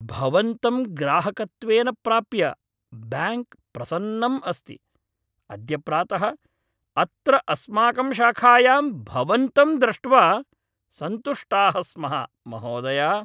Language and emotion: Sanskrit, happy